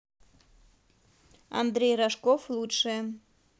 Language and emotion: Russian, neutral